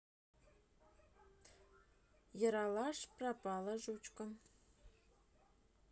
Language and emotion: Russian, neutral